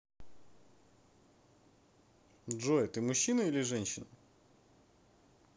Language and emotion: Russian, neutral